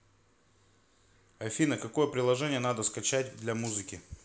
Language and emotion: Russian, neutral